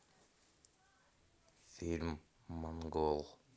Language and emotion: Russian, neutral